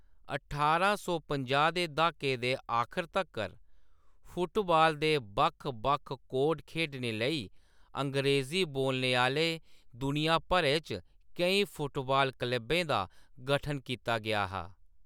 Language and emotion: Dogri, neutral